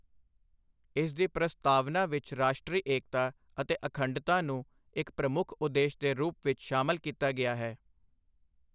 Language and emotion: Punjabi, neutral